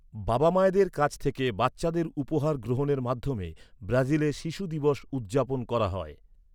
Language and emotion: Bengali, neutral